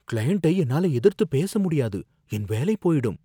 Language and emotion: Tamil, fearful